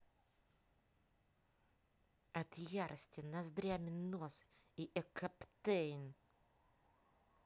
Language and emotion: Russian, angry